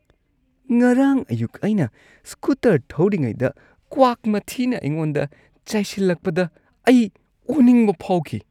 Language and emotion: Manipuri, disgusted